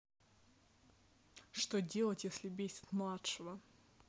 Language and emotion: Russian, angry